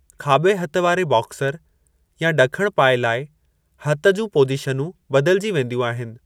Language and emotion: Sindhi, neutral